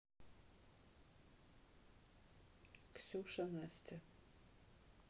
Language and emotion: Russian, neutral